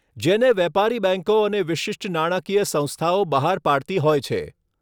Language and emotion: Gujarati, neutral